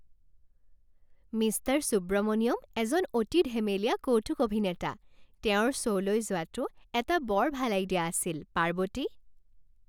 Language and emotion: Assamese, happy